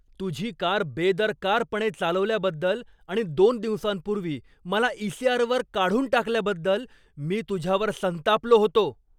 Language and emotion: Marathi, angry